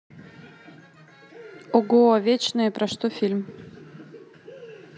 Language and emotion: Russian, positive